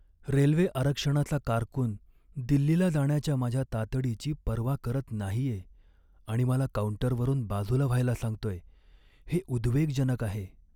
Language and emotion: Marathi, sad